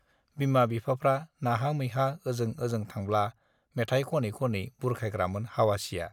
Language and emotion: Bodo, neutral